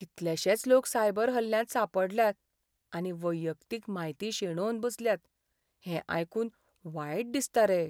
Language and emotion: Goan Konkani, sad